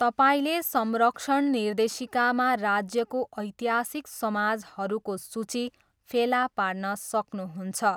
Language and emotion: Nepali, neutral